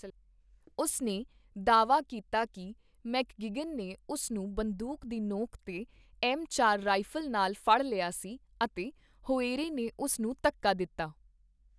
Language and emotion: Punjabi, neutral